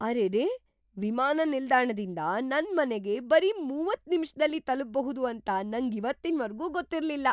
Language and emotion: Kannada, surprised